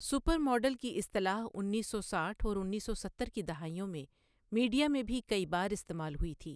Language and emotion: Urdu, neutral